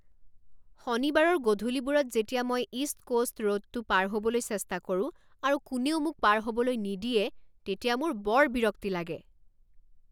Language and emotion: Assamese, angry